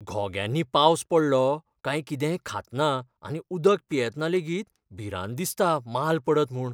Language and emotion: Goan Konkani, fearful